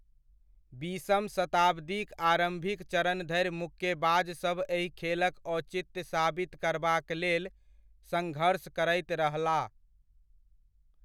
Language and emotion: Maithili, neutral